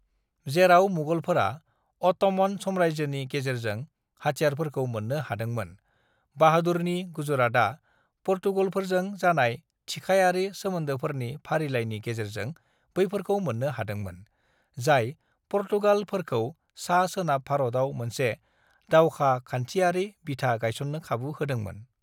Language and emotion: Bodo, neutral